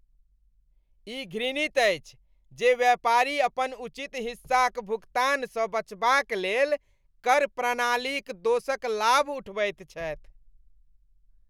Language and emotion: Maithili, disgusted